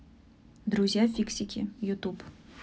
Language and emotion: Russian, neutral